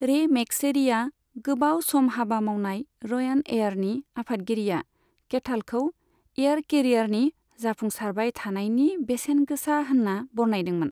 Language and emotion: Bodo, neutral